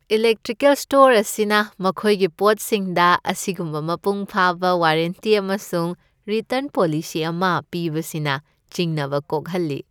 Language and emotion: Manipuri, happy